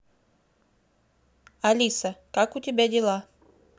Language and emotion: Russian, neutral